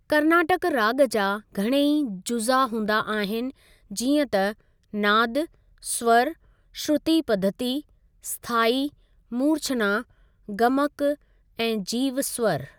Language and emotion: Sindhi, neutral